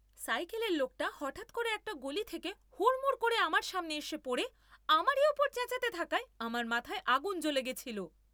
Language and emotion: Bengali, angry